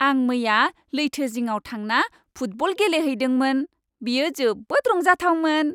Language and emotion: Bodo, happy